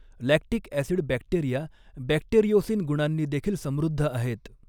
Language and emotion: Marathi, neutral